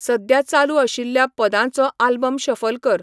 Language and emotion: Goan Konkani, neutral